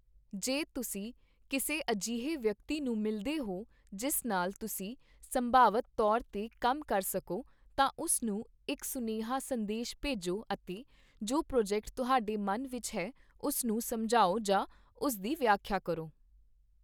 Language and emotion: Punjabi, neutral